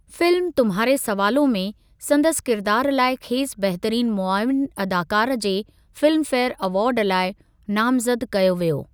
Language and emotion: Sindhi, neutral